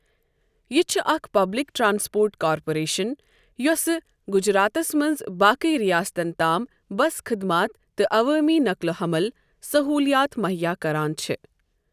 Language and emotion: Kashmiri, neutral